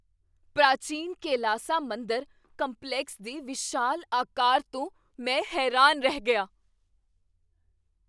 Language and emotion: Punjabi, surprised